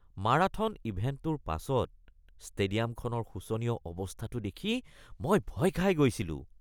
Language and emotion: Assamese, disgusted